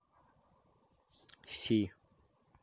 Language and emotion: Russian, neutral